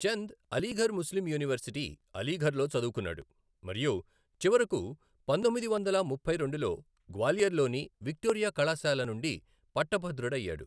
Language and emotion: Telugu, neutral